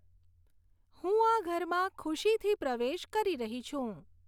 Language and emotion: Gujarati, neutral